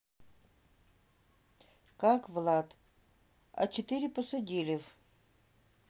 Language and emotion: Russian, neutral